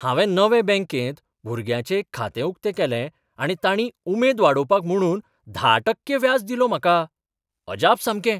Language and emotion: Goan Konkani, surprised